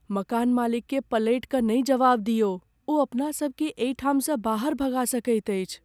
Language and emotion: Maithili, fearful